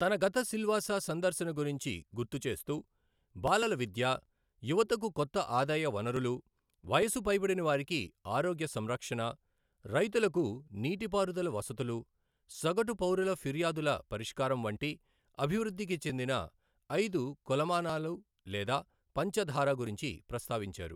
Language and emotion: Telugu, neutral